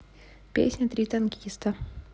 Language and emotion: Russian, neutral